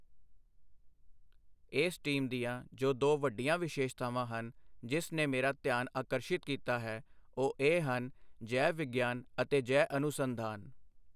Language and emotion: Punjabi, neutral